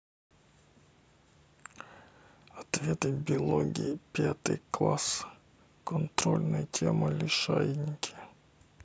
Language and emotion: Russian, neutral